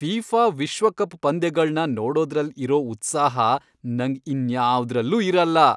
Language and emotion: Kannada, happy